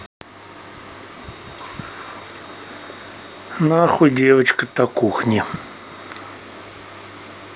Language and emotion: Russian, neutral